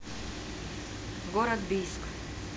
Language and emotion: Russian, neutral